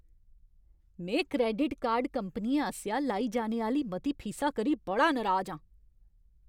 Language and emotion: Dogri, angry